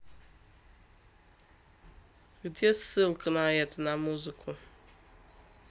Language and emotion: Russian, neutral